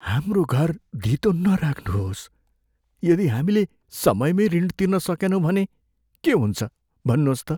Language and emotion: Nepali, fearful